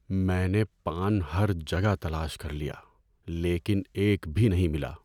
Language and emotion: Urdu, sad